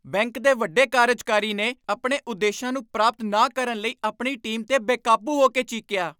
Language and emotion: Punjabi, angry